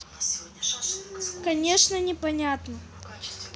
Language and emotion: Russian, neutral